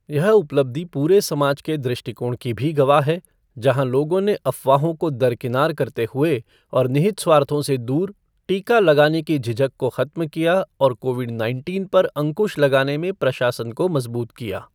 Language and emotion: Hindi, neutral